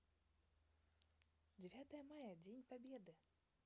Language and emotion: Russian, positive